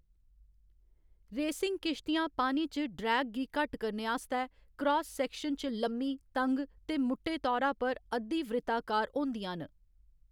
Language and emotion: Dogri, neutral